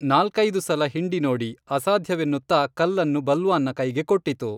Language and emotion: Kannada, neutral